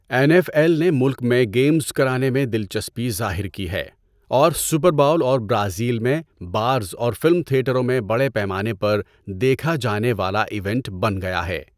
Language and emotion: Urdu, neutral